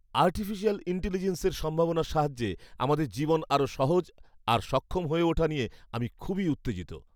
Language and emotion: Bengali, happy